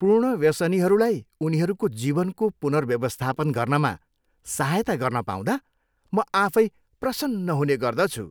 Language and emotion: Nepali, happy